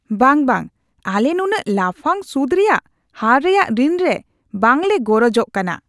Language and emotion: Santali, disgusted